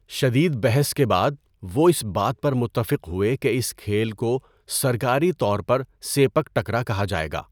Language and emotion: Urdu, neutral